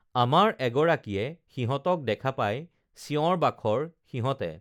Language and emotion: Assamese, neutral